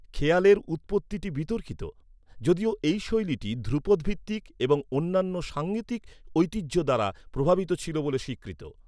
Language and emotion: Bengali, neutral